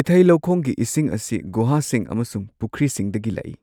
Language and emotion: Manipuri, neutral